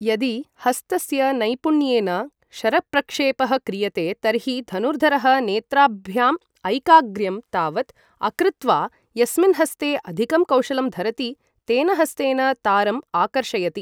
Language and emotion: Sanskrit, neutral